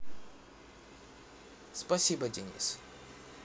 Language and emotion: Russian, neutral